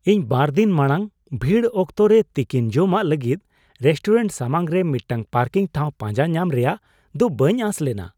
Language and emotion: Santali, surprised